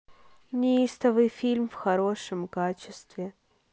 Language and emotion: Russian, sad